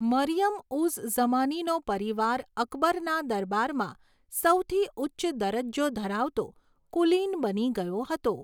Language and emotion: Gujarati, neutral